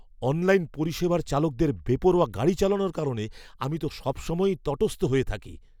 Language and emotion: Bengali, fearful